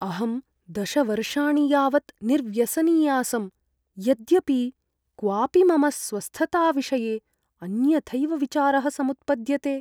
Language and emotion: Sanskrit, fearful